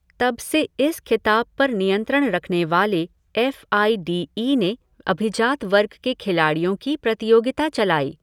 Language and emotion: Hindi, neutral